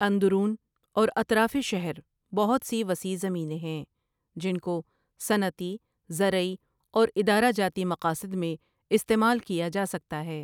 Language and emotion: Urdu, neutral